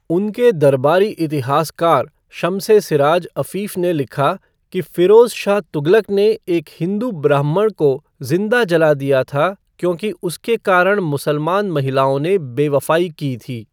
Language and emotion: Hindi, neutral